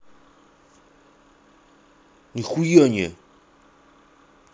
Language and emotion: Russian, angry